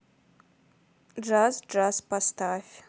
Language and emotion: Russian, neutral